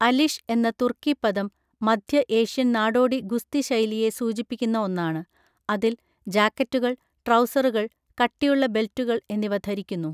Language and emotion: Malayalam, neutral